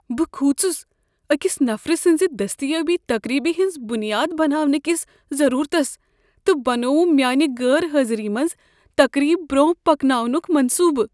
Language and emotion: Kashmiri, fearful